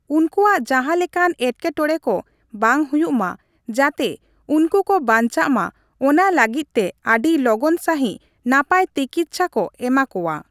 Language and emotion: Santali, neutral